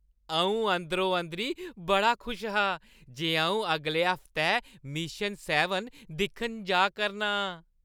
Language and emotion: Dogri, happy